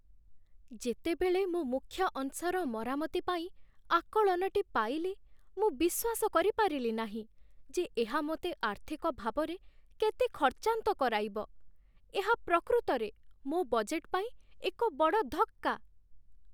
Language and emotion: Odia, sad